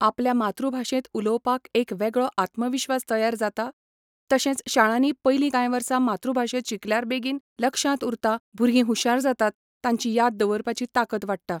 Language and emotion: Goan Konkani, neutral